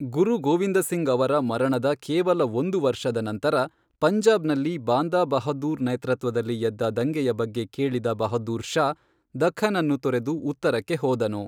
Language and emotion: Kannada, neutral